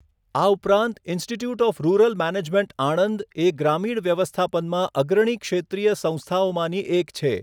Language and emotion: Gujarati, neutral